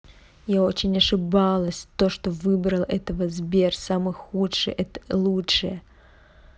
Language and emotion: Russian, angry